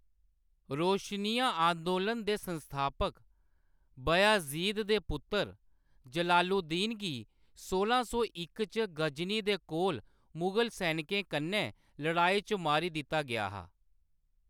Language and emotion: Dogri, neutral